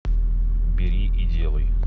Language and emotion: Russian, neutral